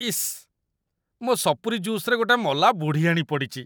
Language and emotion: Odia, disgusted